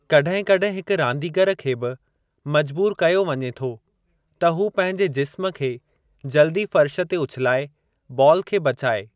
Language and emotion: Sindhi, neutral